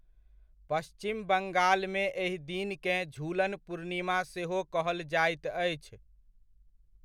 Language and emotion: Maithili, neutral